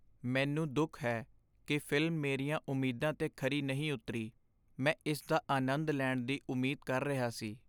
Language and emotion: Punjabi, sad